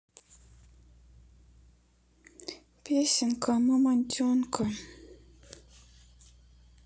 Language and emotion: Russian, sad